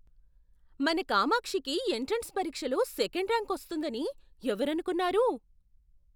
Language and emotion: Telugu, surprised